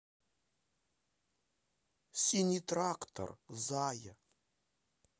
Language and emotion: Russian, positive